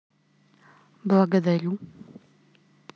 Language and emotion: Russian, neutral